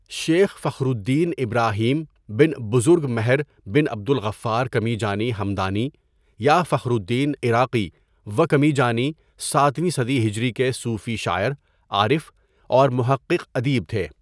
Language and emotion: Urdu, neutral